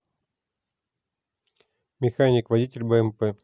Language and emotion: Russian, neutral